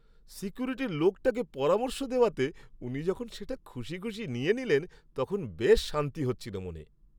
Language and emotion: Bengali, happy